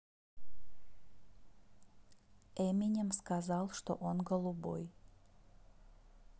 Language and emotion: Russian, neutral